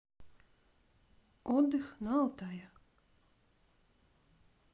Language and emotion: Russian, neutral